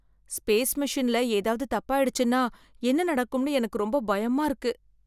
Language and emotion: Tamil, fearful